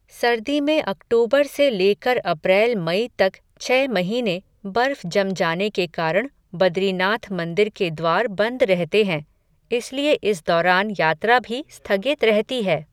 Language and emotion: Hindi, neutral